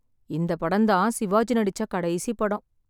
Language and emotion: Tamil, sad